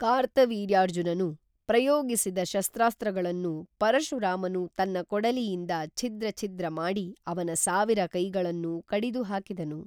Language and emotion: Kannada, neutral